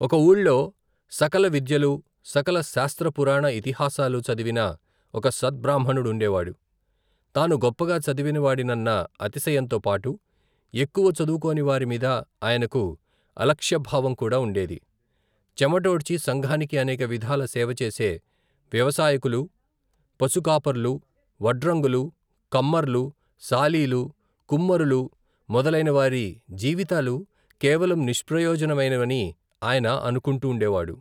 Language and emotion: Telugu, neutral